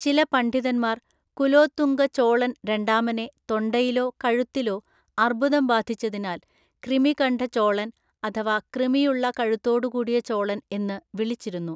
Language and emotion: Malayalam, neutral